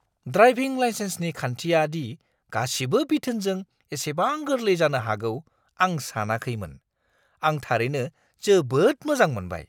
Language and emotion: Bodo, surprised